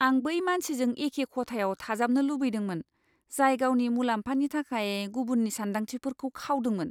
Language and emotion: Bodo, disgusted